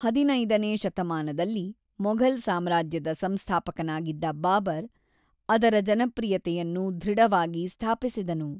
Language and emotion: Kannada, neutral